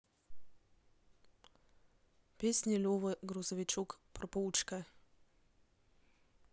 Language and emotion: Russian, neutral